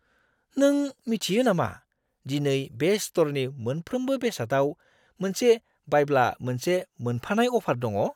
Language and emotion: Bodo, surprised